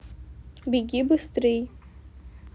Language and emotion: Russian, neutral